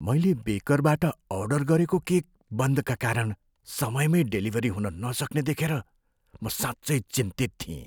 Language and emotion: Nepali, fearful